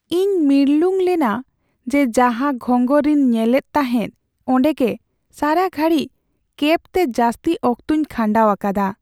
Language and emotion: Santali, sad